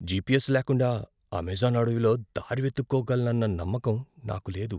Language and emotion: Telugu, fearful